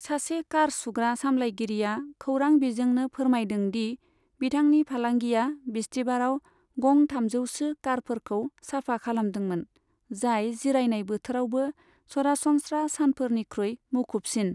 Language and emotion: Bodo, neutral